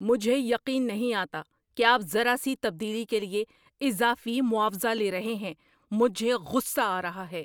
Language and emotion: Urdu, angry